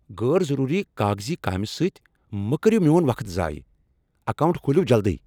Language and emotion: Kashmiri, angry